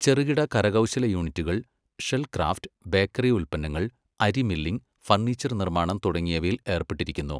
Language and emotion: Malayalam, neutral